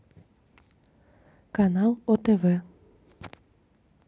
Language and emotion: Russian, neutral